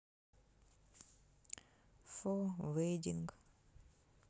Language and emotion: Russian, sad